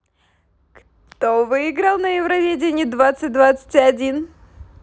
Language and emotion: Russian, positive